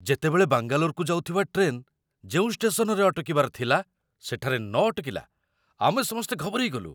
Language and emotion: Odia, surprised